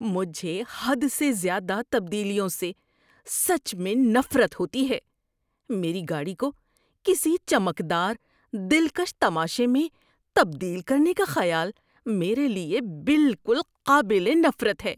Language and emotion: Urdu, disgusted